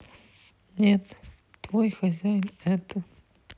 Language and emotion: Russian, sad